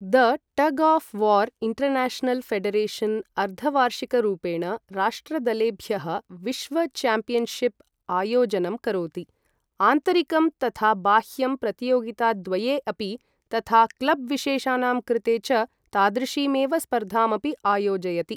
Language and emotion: Sanskrit, neutral